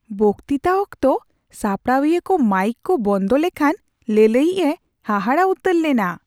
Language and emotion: Santali, surprised